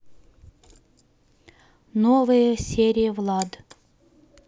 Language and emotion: Russian, neutral